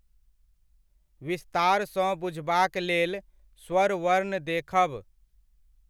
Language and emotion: Maithili, neutral